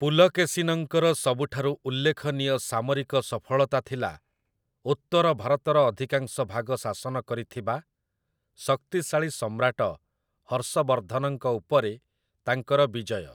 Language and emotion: Odia, neutral